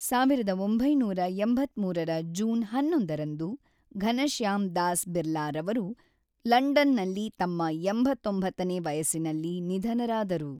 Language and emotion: Kannada, neutral